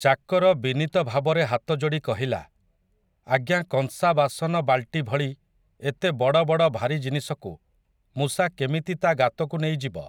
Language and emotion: Odia, neutral